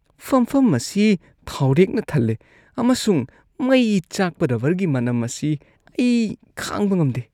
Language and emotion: Manipuri, disgusted